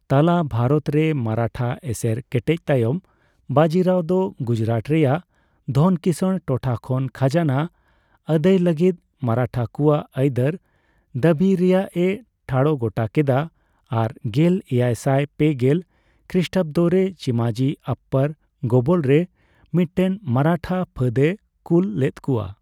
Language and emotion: Santali, neutral